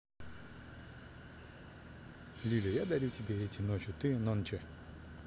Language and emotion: Russian, neutral